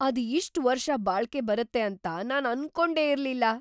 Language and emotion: Kannada, surprised